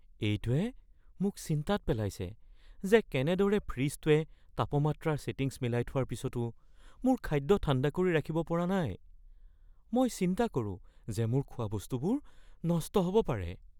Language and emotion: Assamese, fearful